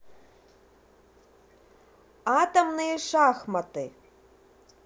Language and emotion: Russian, positive